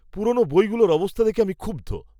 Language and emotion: Bengali, disgusted